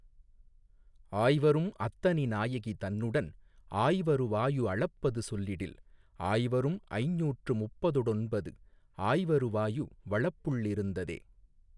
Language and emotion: Tamil, neutral